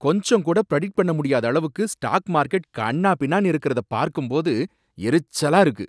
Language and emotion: Tamil, angry